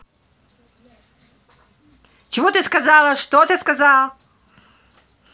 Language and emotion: Russian, angry